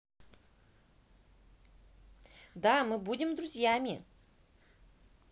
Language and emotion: Russian, positive